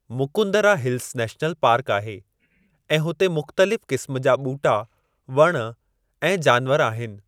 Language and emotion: Sindhi, neutral